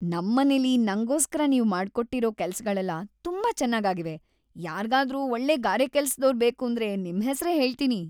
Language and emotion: Kannada, happy